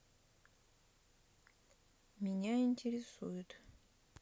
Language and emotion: Russian, neutral